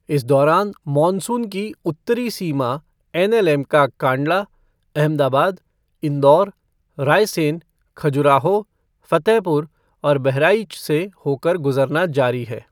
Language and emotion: Hindi, neutral